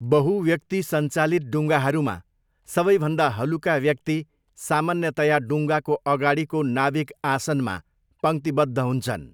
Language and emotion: Nepali, neutral